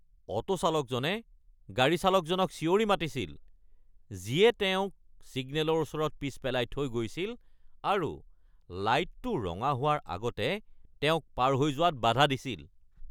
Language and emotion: Assamese, angry